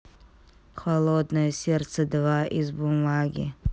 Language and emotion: Russian, neutral